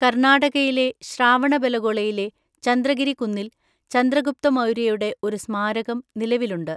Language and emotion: Malayalam, neutral